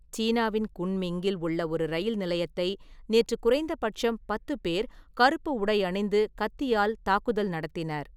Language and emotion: Tamil, neutral